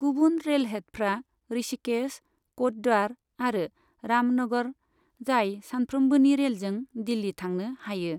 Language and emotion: Bodo, neutral